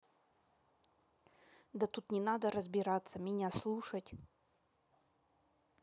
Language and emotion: Russian, angry